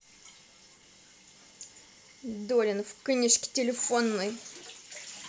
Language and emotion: Russian, angry